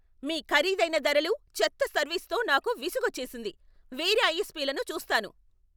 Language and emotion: Telugu, angry